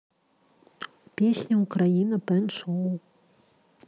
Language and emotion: Russian, neutral